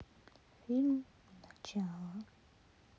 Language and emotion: Russian, sad